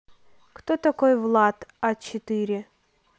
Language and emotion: Russian, neutral